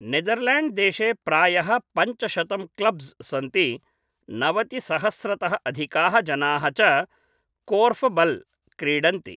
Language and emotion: Sanskrit, neutral